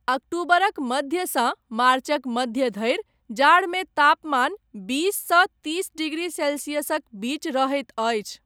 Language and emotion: Maithili, neutral